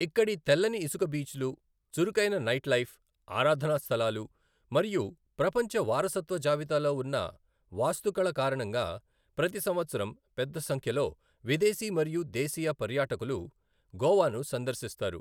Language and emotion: Telugu, neutral